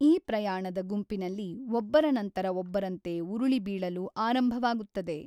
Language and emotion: Kannada, neutral